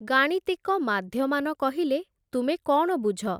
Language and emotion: Odia, neutral